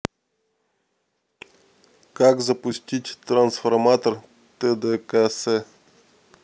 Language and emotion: Russian, neutral